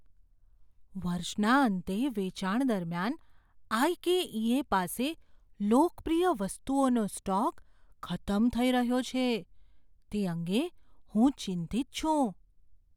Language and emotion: Gujarati, fearful